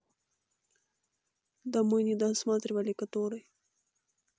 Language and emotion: Russian, neutral